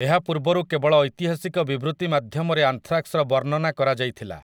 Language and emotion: Odia, neutral